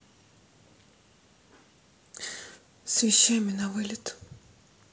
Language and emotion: Russian, sad